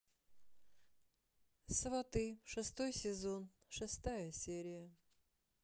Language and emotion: Russian, sad